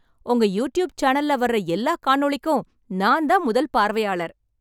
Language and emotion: Tamil, happy